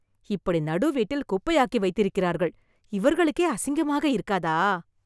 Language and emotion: Tamil, disgusted